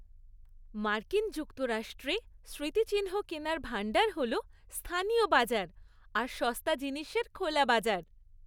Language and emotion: Bengali, happy